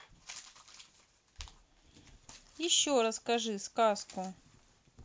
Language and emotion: Russian, neutral